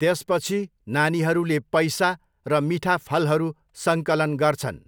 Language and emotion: Nepali, neutral